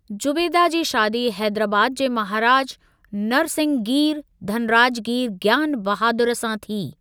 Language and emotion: Sindhi, neutral